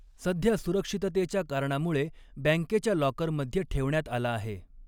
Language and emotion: Marathi, neutral